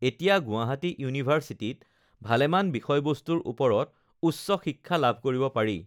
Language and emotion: Assamese, neutral